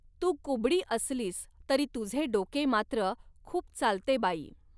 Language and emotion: Marathi, neutral